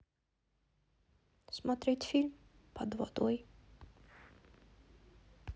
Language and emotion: Russian, neutral